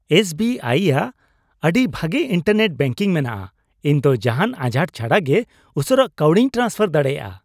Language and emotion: Santali, happy